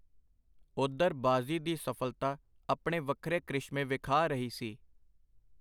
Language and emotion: Punjabi, neutral